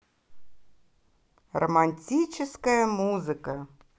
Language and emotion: Russian, positive